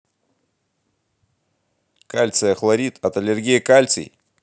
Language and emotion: Russian, positive